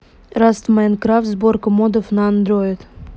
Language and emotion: Russian, neutral